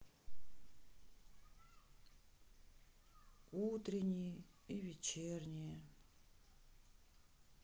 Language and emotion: Russian, sad